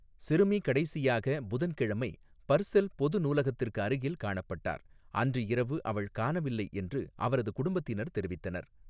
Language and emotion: Tamil, neutral